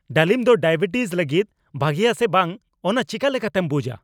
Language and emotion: Santali, angry